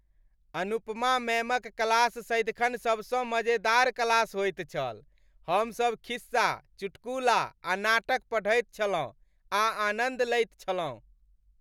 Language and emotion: Maithili, happy